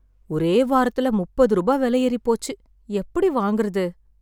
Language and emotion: Tamil, sad